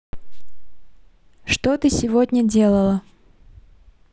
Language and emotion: Russian, neutral